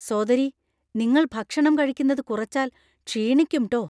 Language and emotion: Malayalam, fearful